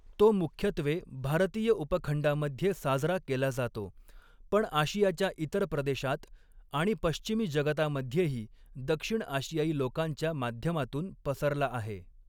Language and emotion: Marathi, neutral